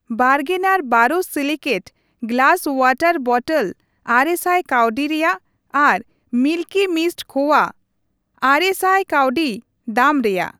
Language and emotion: Santali, neutral